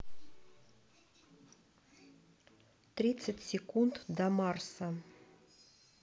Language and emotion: Russian, neutral